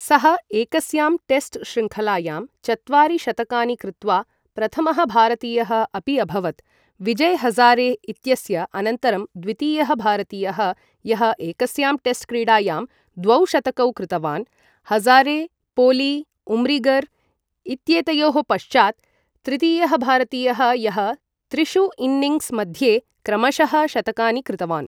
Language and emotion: Sanskrit, neutral